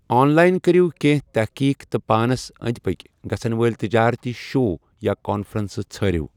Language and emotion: Kashmiri, neutral